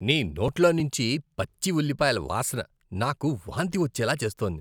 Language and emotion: Telugu, disgusted